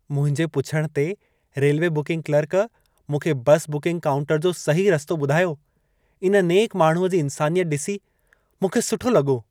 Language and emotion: Sindhi, happy